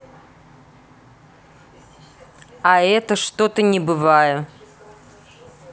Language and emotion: Russian, neutral